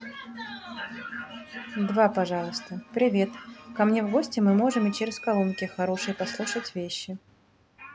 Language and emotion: Russian, neutral